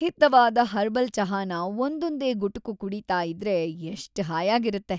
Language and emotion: Kannada, happy